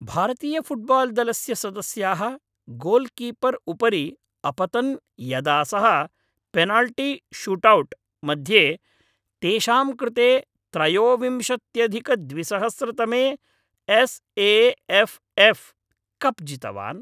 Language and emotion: Sanskrit, happy